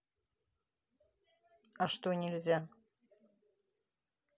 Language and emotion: Russian, neutral